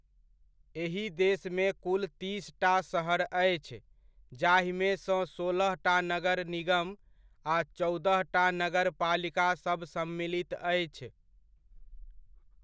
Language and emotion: Maithili, neutral